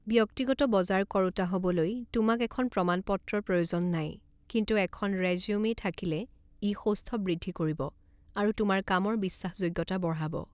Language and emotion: Assamese, neutral